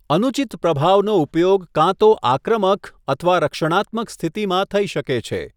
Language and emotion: Gujarati, neutral